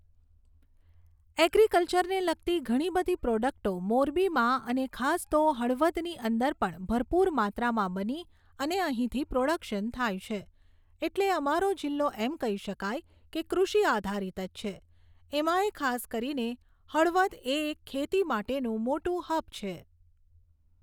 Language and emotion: Gujarati, neutral